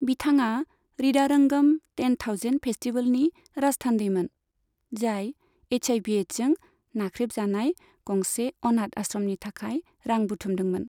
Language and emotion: Bodo, neutral